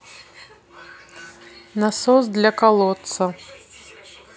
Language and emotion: Russian, neutral